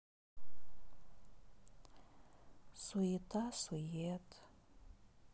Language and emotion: Russian, sad